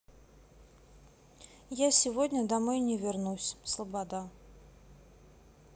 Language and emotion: Russian, neutral